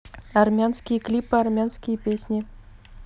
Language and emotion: Russian, neutral